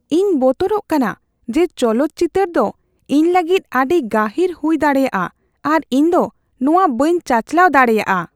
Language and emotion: Santali, fearful